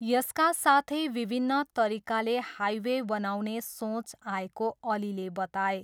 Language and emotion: Nepali, neutral